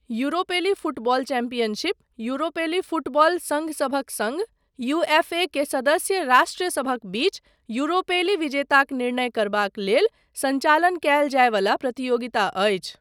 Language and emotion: Maithili, neutral